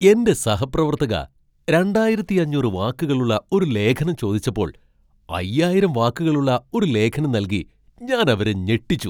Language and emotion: Malayalam, surprised